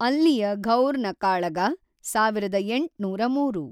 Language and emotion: Kannada, neutral